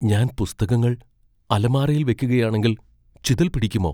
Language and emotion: Malayalam, fearful